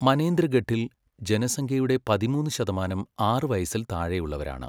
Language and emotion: Malayalam, neutral